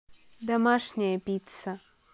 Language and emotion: Russian, neutral